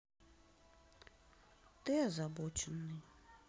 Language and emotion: Russian, sad